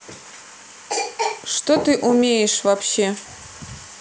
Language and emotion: Russian, neutral